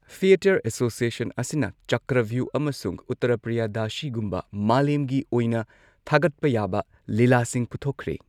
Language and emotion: Manipuri, neutral